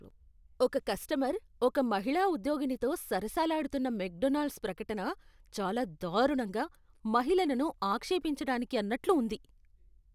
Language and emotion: Telugu, disgusted